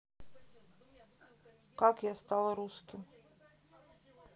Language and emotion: Russian, neutral